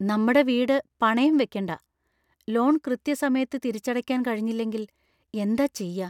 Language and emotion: Malayalam, fearful